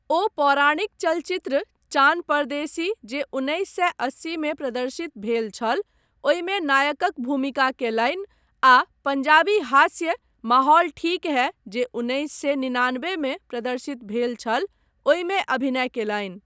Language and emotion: Maithili, neutral